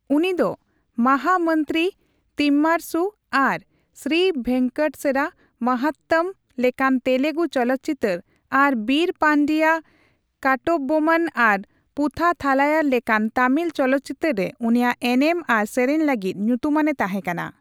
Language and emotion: Santali, neutral